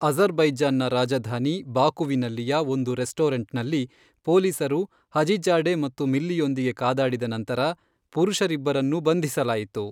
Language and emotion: Kannada, neutral